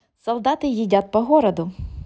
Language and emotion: Russian, positive